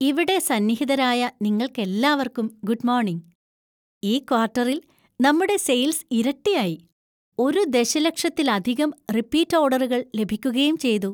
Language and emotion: Malayalam, happy